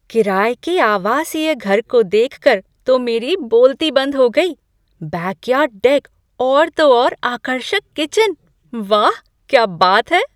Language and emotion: Hindi, surprised